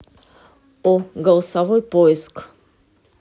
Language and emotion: Russian, neutral